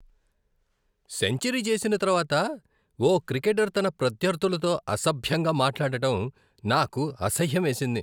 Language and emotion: Telugu, disgusted